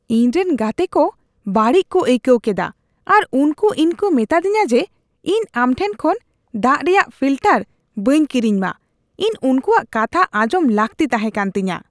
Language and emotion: Santali, disgusted